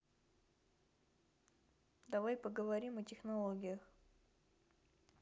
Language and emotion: Russian, neutral